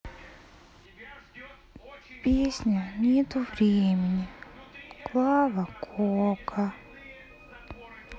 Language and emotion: Russian, sad